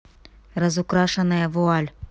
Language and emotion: Russian, neutral